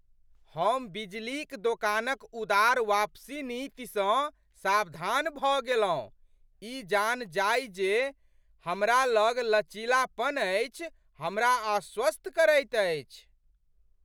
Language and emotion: Maithili, surprised